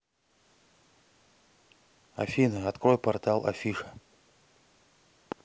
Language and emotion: Russian, neutral